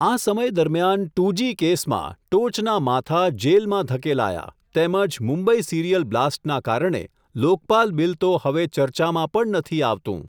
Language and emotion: Gujarati, neutral